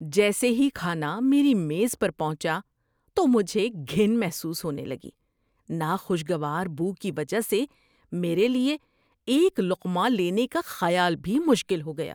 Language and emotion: Urdu, disgusted